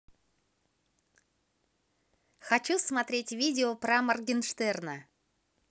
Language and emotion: Russian, positive